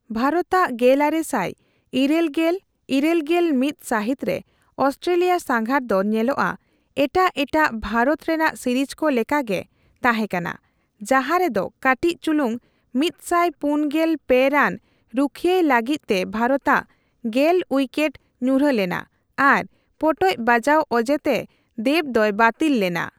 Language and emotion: Santali, neutral